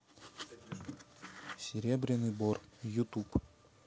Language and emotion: Russian, neutral